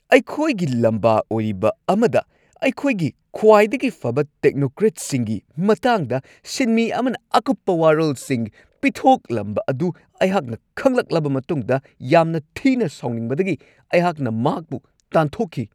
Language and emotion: Manipuri, angry